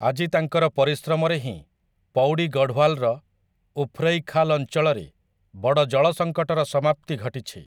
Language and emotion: Odia, neutral